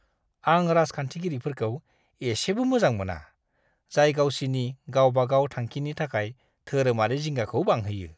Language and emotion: Bodo, disgusted